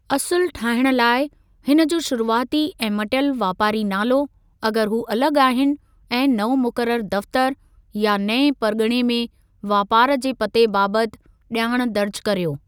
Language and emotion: Sindhi, neutral